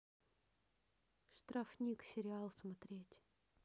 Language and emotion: Russian, neutral